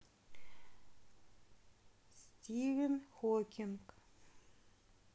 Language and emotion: Russian, neutral